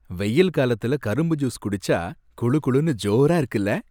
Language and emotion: Tamil, happy